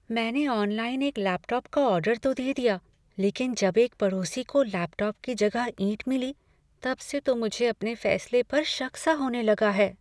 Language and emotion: Hindi, fearful